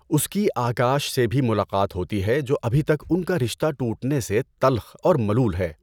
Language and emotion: Urdu, neutral